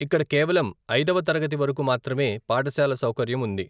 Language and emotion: Telugu, neutral